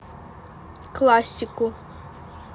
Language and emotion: Russian, neutral